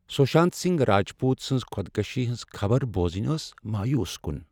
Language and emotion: Kashmiri, sad